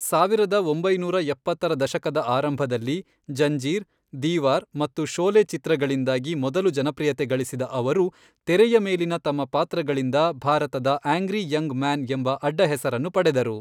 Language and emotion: Kannada, neutral